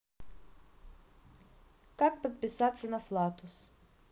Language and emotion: Russian, neutral